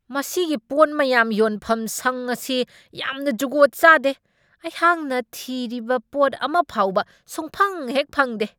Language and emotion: Manipuri, angry